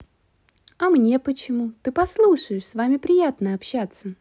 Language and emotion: Russian, positive